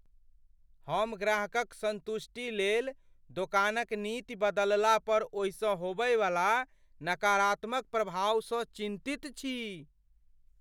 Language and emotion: Maithili, fearful